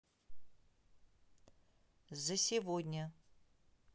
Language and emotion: Russian, neutral